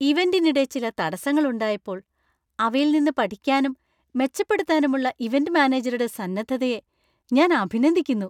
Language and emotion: Malayalam, happy